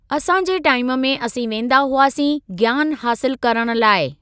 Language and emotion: Sindhi, neutral